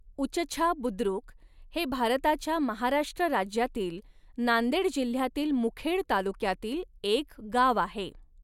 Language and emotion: Marathi, neutral